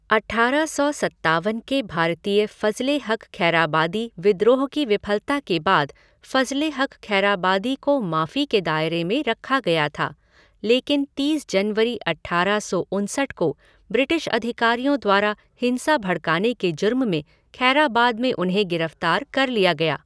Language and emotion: Hindi, neutral